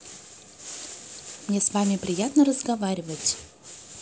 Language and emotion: Russian, positive